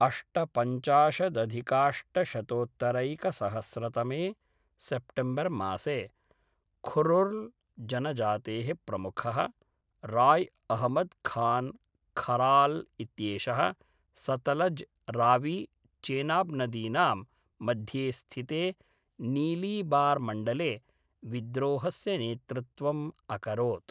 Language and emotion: Sanskrit, neutral